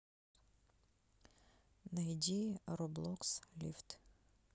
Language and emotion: Russian, neutral